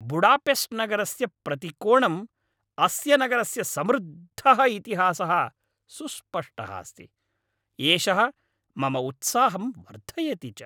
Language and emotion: Sanskrit, happy